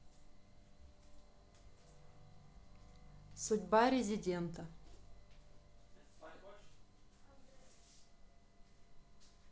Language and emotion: Russian, neutral